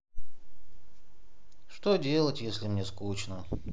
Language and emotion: Russian, sad